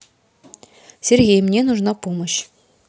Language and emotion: Russian, neutral